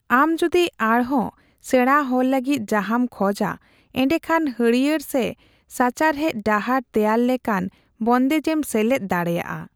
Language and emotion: Santali, neutral